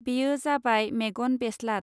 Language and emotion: Bodo, neutral